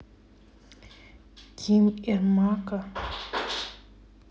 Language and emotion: Russian, neutral